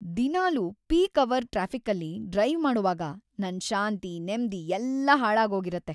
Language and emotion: Kannada, sad